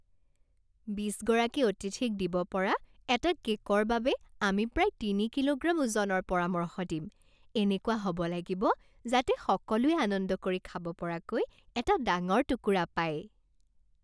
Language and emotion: Assamese, happy